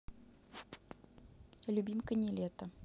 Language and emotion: Russian, neutral